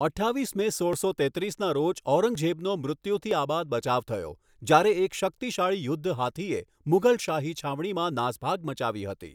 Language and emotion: Gujarati, neutral